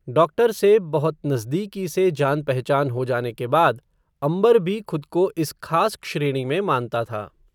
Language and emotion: Hindi, neutral